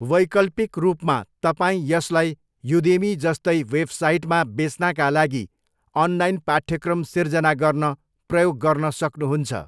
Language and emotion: Nepali, neutral